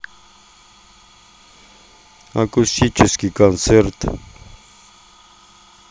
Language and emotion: Russian, neutral